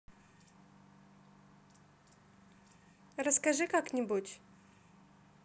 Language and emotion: Russian, neutral